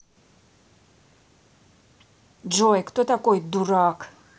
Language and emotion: Russian, angry